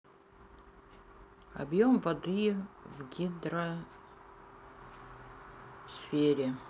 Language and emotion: Russian, neutral